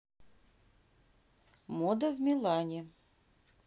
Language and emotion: Russian, neutral